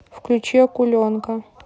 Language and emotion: Russian, neutral